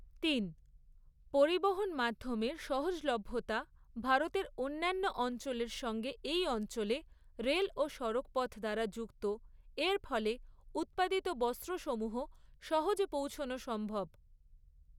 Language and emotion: Bengali, neutral